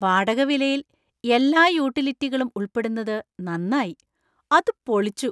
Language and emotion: Malayalam, surprised